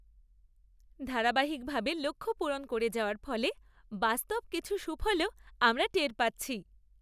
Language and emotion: Bengali, happy